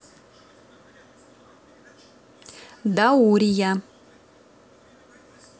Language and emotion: Russian, neutral